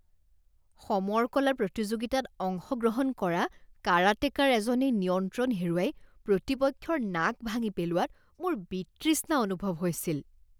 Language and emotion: Assamese, disgusted